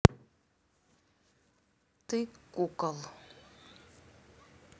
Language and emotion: Russian, angry